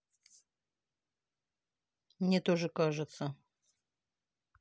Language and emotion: Russian, neutral